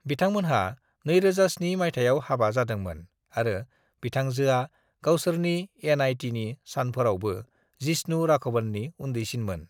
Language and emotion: Bodo, neutral